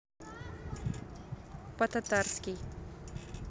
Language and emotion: Russian, neutral